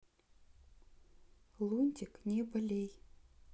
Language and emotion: Russian, neutral